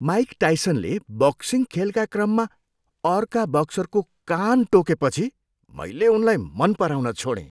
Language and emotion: Nepali, disgusted